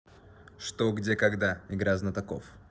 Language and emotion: Russian, neutral